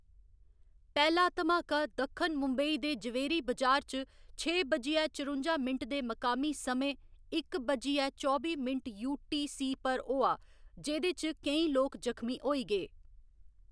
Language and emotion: Dogri, neutral